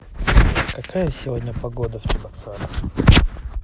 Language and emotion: Russian, neutral